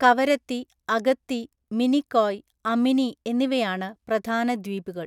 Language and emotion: Malayalam, neutral